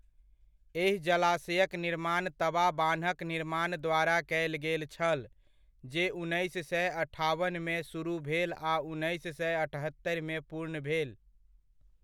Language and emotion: Maithili, neutral